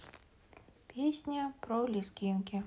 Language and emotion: Russian, neutral